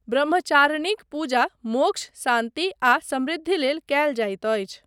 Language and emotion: Maithili, neutral